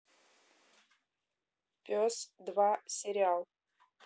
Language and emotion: Russian, neutral